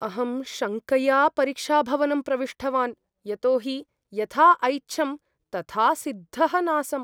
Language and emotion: Sanskrit, fearful